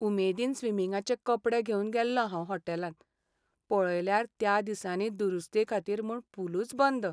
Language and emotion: Goan Konkani, sad